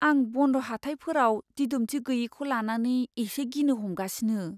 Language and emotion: Bodo, fearful